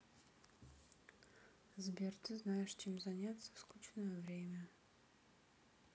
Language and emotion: Russian, sad